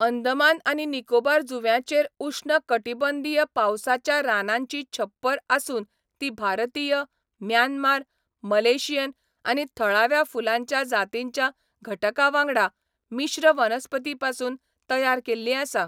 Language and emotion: Goan Konkani, neutral